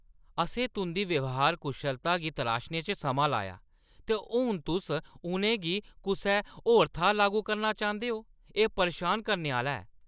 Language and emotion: Dogri, angry